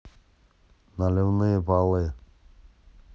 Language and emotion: Russian, neutral